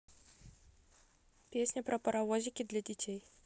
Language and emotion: Russian, neutral